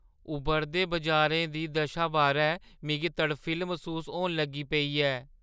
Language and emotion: Dogri, fearful